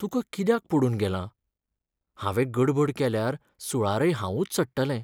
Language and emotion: Goan Konkani, sad